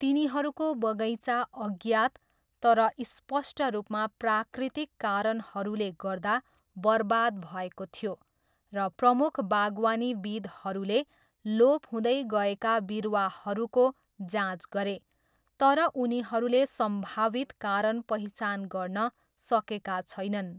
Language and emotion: Nepali, neutral